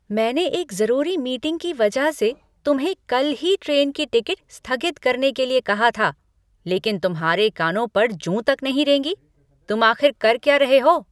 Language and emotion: Hindi, angry